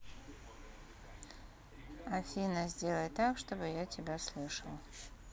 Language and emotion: Russian, neutral